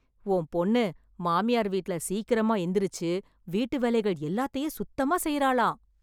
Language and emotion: Tamil, happy